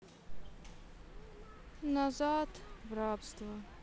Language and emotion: Russian, sad